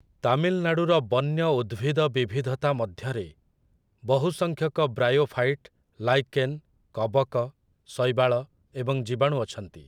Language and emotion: Odia, neutral